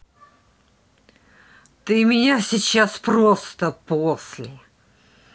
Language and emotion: Russian, angry